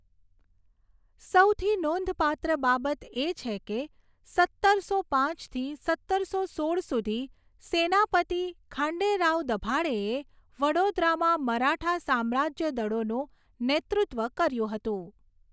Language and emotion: Gujarati, neutral